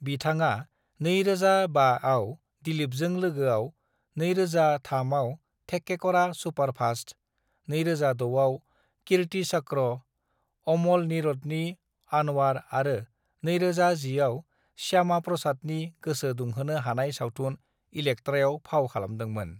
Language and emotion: Bodo, neutral